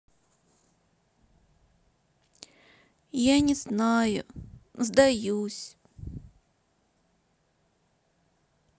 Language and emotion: Russian, sad